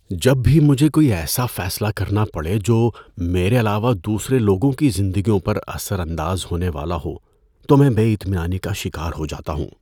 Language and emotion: Urdu, fearful